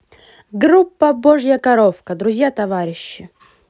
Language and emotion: Russian, positive